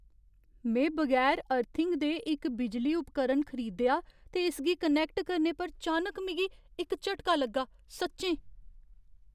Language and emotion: Dogri, fearful